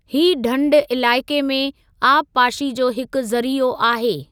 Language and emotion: Sindhi, neutral